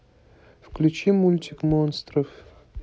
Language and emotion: Russian, neutral